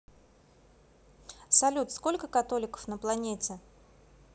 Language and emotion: Russian, neutral